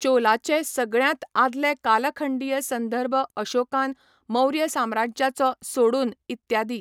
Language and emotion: Goan Konkani, neutral